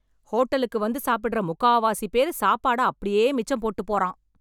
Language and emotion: Tamil, angry